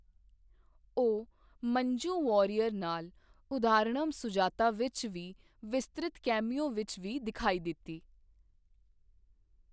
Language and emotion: Punjabi, neutral